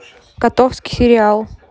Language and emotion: Russian, neutral